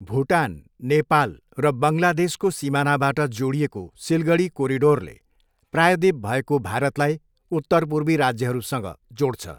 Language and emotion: Nepali, neutral